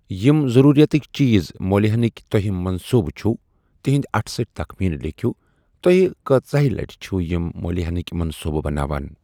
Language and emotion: Kashmiri, neutral